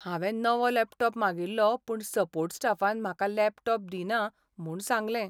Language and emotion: Goan Konkani, sad